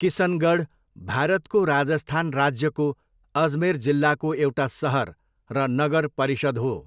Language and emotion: Nepali, neutral